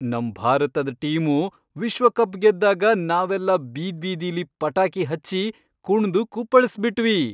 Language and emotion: Kannada, happy